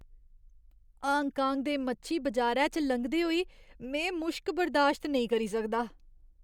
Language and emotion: Dogri, disgusted